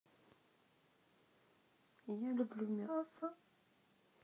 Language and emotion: Russian, sad